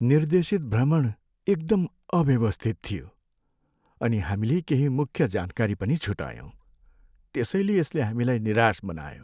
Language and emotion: Nepali, sad